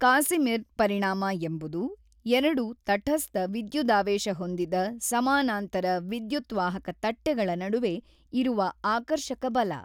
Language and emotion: Kannada, neutral